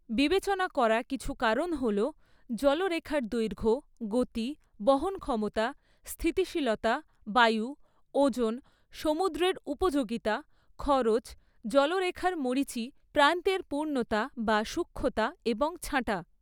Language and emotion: Bengali, neutral